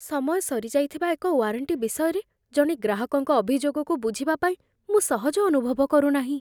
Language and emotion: Odia, fearful